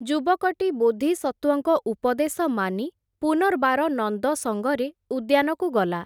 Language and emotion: Odia, neutral